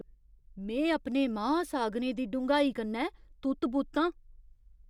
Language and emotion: Dogri, surprised